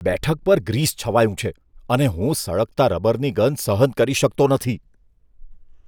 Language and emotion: Gujarati, disgusted